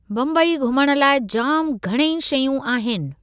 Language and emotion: Sindhi, neutral